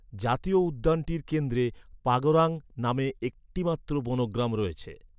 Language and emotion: Bengali, neutral